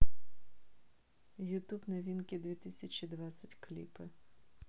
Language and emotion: Russian, neutral